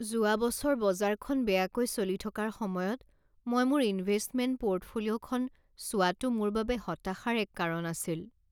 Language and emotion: Assamese, sad